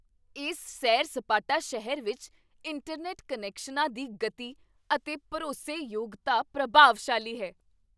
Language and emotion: Punjabi, surprised